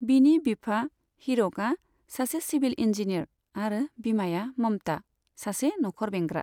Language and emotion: Bodo, neutral